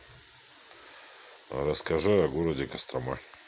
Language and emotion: Russian, neutral